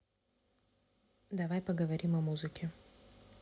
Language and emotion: Russian, neutral